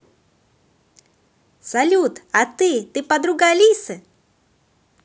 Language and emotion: Russian, positive